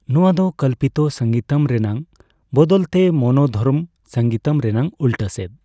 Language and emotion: Santali, neutral